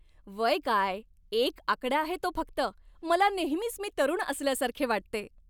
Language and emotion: Marathi, happy